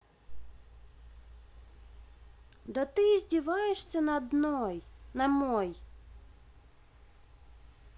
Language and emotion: Russian, angry